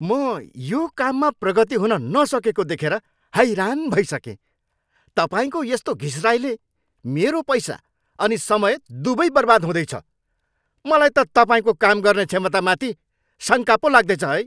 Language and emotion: Nepali, angry